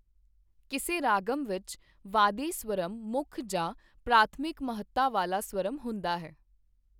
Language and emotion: Punjabi, neutral